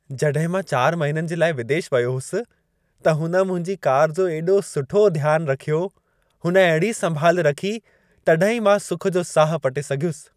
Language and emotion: Sindhi, happy